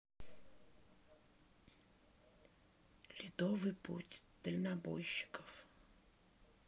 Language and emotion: Russian, sad